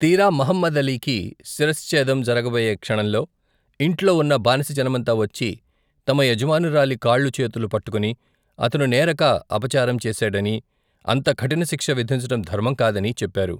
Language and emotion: Telugu, neutral